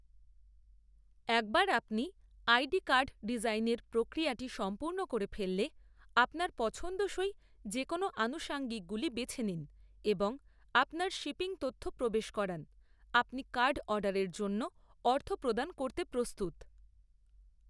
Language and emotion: Bengali, neutral